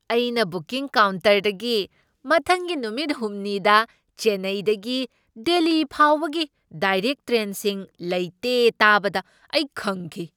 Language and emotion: Manipuri, surprised